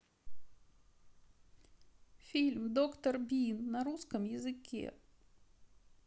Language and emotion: Russian, sad